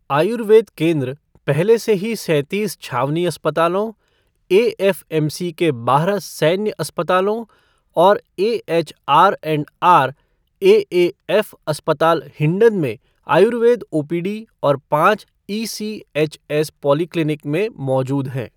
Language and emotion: Hindi, neutral